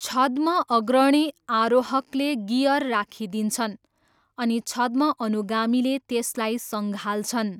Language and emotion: Nepali, neutral